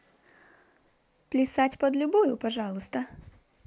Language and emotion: Russian, positive